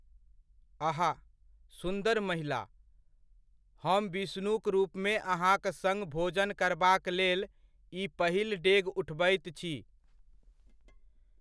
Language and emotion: Maithili, neutral